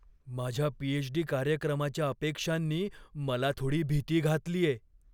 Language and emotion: Marathi, fearful